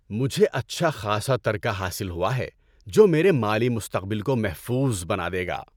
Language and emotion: Urdu, happy